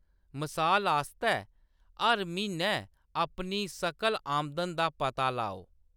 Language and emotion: Dogri, neutral